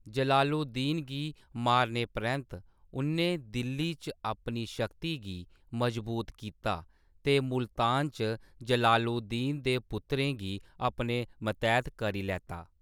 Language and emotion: Dogri, neutral